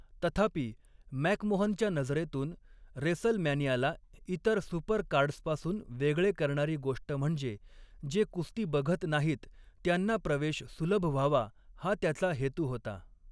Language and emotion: Marathi, neutral